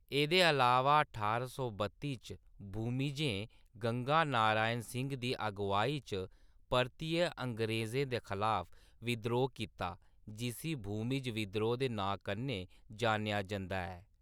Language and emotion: Dogri, neutral